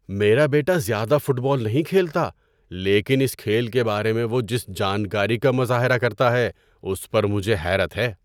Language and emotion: Urdu, surprised